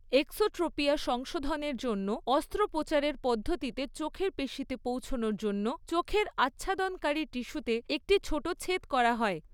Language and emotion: Bengali, neutral